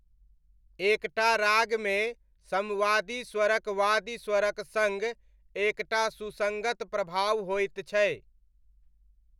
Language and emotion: Maithili, neutral